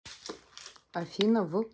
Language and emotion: Russian, neutral